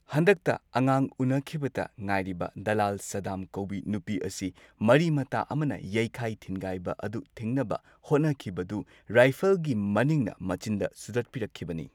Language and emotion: Manipuri, neutral